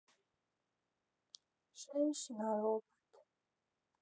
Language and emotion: Russian, sad